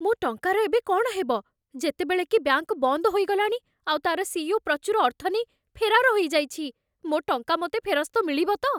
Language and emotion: Odia, fearful